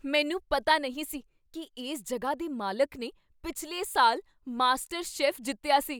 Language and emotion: Punjabi, surprised